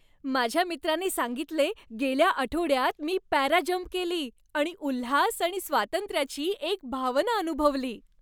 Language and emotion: Marathi, happy